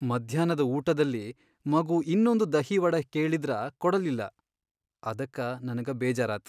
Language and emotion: Kannada, sad